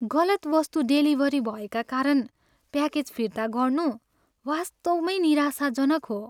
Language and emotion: Nepali, sad